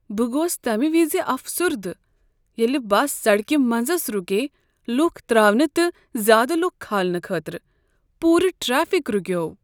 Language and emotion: Kashmiri, sad